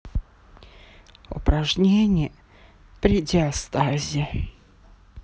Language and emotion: Russian, sad